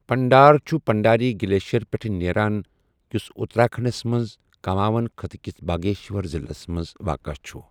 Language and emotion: Kashmiri, neutral